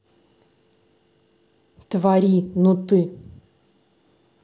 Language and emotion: Russian, angry